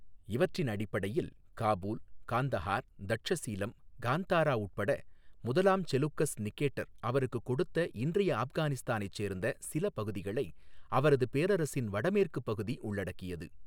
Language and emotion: Tamil, neutral